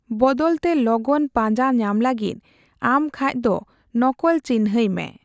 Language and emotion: Santali, neutral